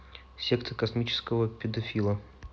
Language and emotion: Russian, neutral